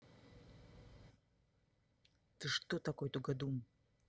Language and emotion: Russian, angry